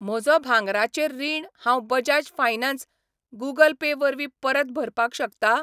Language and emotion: Goan Konkani, neutral